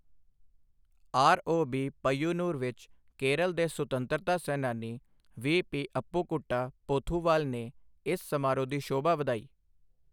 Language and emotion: Punjabi, neutral